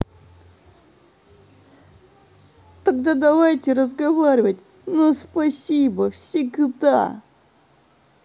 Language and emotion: Russian, sad